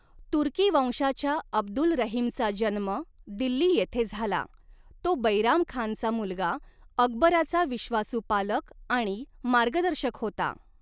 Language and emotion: Marathi, neutral